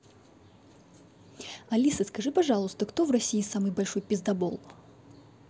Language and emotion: Russian, angry